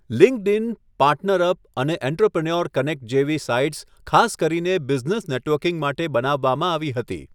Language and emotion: Gujarati, neutral